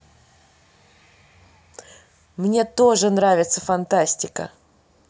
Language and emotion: Russian, positive